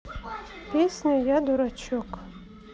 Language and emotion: Russian, neutral